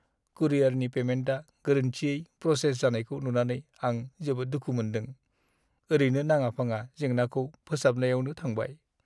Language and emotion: Bodo, sad